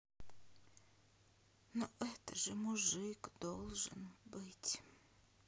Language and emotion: Russian, sad